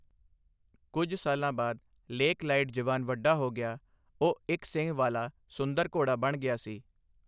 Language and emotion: Punjabi, neutral